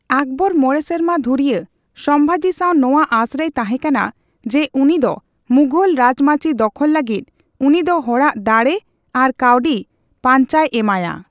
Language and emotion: Santali, neutral